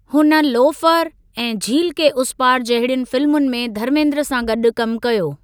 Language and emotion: Sindhi, neutral